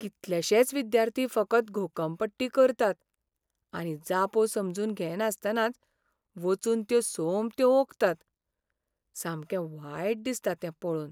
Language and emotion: Goan Konkani, sad